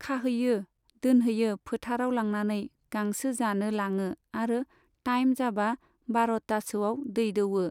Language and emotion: Bodo, neutral